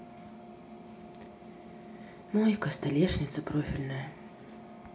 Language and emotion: Russian, sad